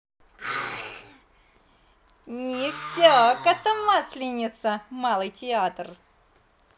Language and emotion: Russian, positive